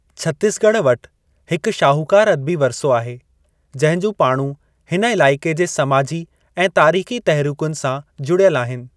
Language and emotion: Sindhi, neutral